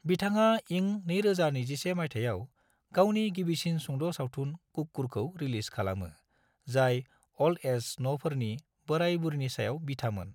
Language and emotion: Bodo, neutral